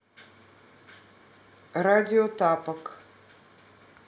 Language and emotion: Russian, neutral